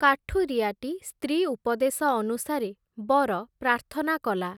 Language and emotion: Odia, neutral